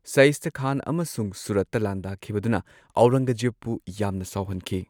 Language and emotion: Manipuri, neutral